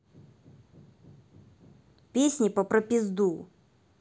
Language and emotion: Russian, angry